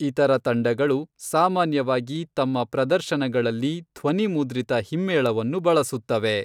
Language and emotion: Kannada, neutral